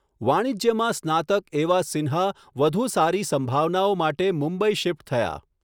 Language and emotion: Gujarati, neutral